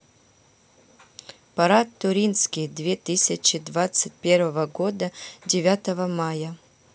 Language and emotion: Russian, neutral